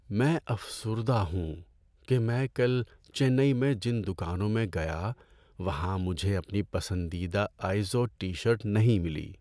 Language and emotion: Urdu, sad